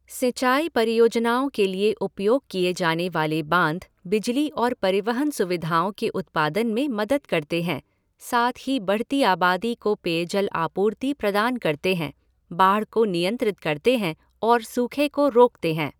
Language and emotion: Hindi, neutral